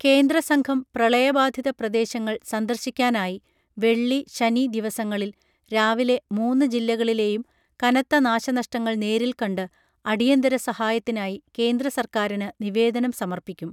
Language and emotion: Malayalam, neutral